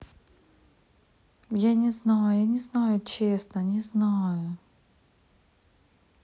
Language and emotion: Russian, sad